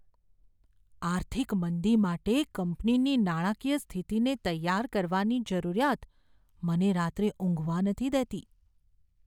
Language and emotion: Gujarati, fearful